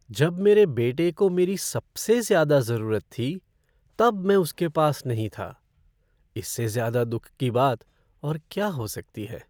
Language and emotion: Hindi, sad